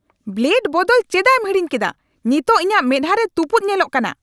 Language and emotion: Santali, angry